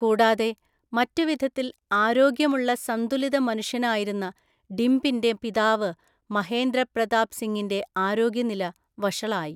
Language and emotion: Malayalam, neutral